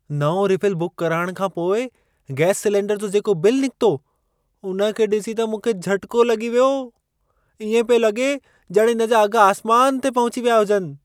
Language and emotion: Sindhi, surprised